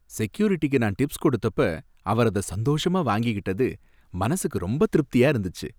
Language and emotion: Tamil, happy